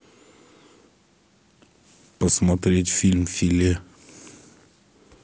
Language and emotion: Russian, neutral